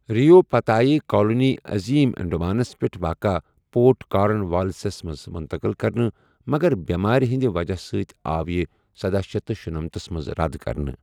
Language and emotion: Kashmiri, neutral